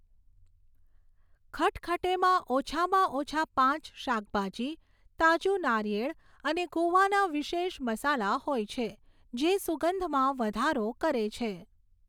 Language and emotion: Gujarati, neutral